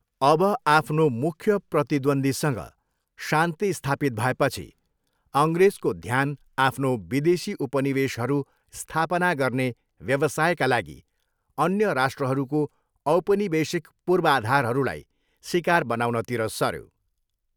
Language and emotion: Nepali, neutral